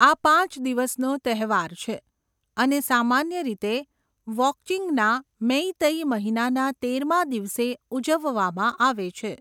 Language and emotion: Gujarati, neutral